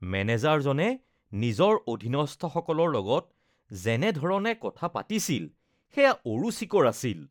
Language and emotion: Assamese, disgusted